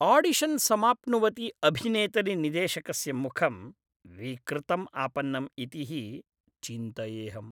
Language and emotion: Sanskrit, disgusted